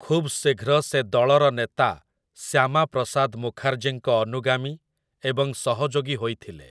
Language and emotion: Odia, neutral